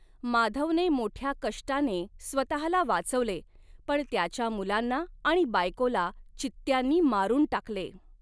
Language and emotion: Marathi, neutral